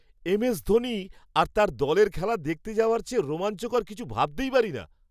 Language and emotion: Bengali, happy